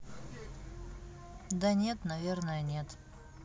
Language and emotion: Russian, sad